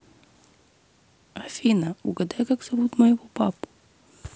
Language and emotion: Russian, neutral